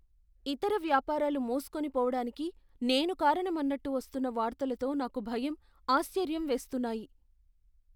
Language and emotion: Telugu, fearful